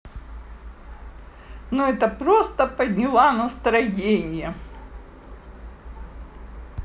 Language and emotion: Russian, positive